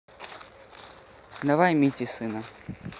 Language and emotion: Russian, neutral